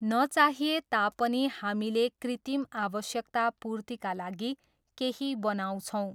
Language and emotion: Nepali, neutral